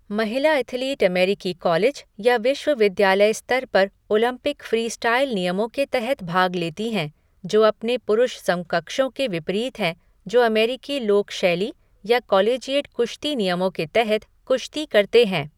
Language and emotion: Hindi, neutral